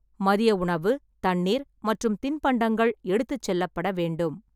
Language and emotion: Tamil, neutral